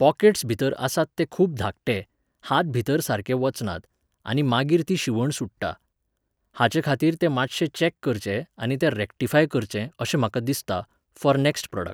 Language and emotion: Goan Konkani, neutral